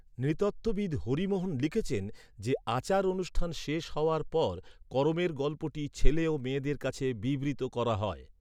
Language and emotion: Bengali, neutral